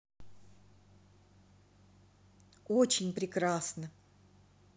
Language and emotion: Russian, positive